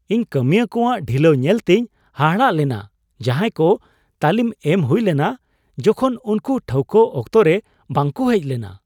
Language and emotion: Santali, surprised